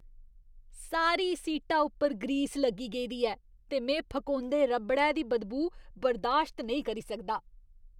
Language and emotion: Dogri, disgusted